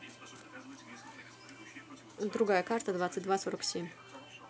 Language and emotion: Russian, neutral